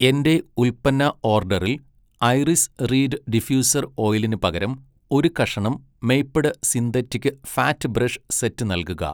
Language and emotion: Malayalam, neutral